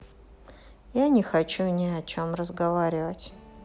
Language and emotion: Russian, sad